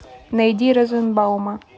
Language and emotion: Russian, neutral